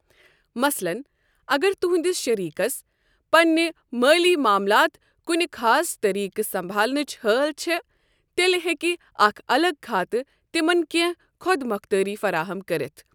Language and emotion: Kashmiri, neutral